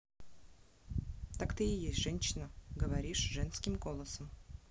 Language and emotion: Russian, neutral